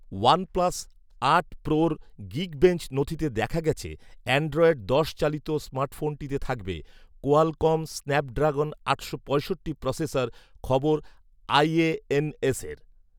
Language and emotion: Bengali, neutral